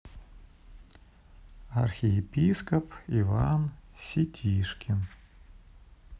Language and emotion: Russian, neutral